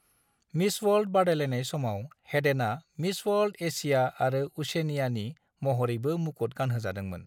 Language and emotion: Bodo, neutral